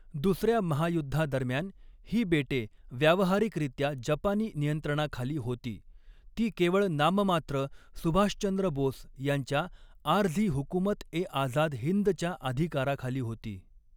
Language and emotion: Marathi, neutral